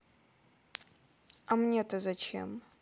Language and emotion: Russian, neutral